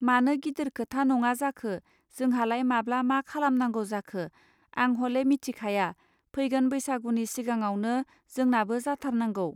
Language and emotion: Bodo, neutral